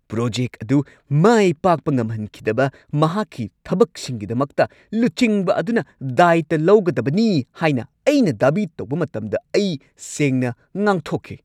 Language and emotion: Manipuri, angry